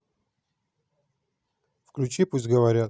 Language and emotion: Russian, neutral